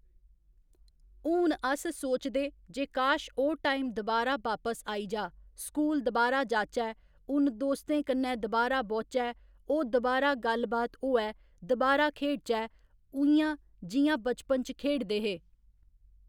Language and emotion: Dogri, neutral